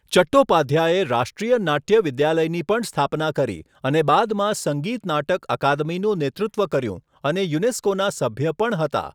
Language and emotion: Gujarati, neutral